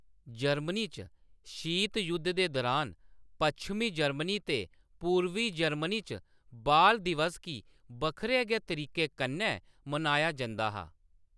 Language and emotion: Dogri, neutral